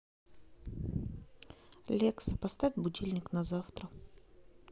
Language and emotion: Russian, neutral